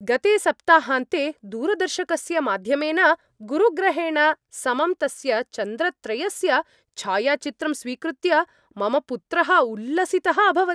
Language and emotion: Sanskrit, happy